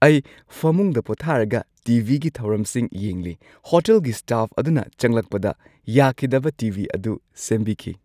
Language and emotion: Manipuri, happy